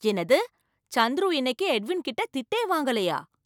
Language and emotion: Tamil, surprised